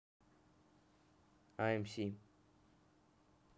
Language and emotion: Russian, neutral